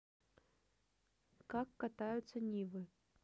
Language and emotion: Russian, neutral